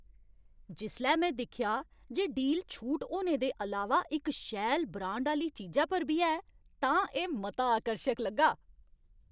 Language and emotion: Dogri, happy